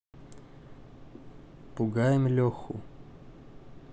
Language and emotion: Russian, neutral